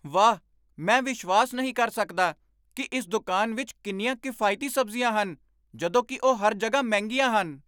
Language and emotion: Punjabi, surprised